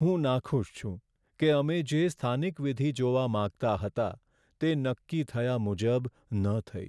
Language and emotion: Gujarati, sad